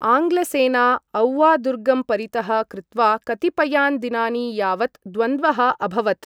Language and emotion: Sanskrit, neutral